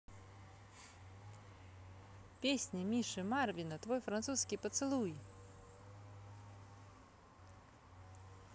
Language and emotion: Russian, positive